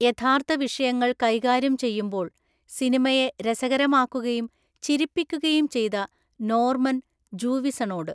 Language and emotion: Malayalam, neutral